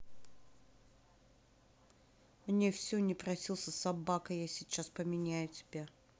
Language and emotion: Russian, angry